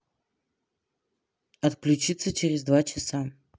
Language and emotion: Russian, neutral